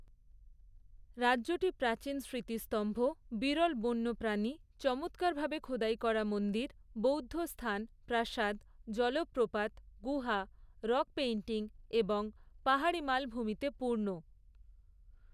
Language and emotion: Bengali, neutral